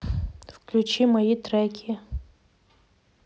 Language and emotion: Russian, neutral